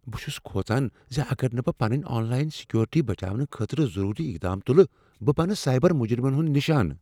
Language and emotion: Kashmiri, fearful